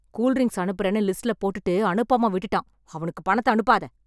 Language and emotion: Tamil, angry